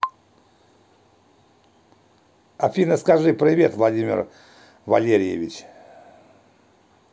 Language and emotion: Russian, neutral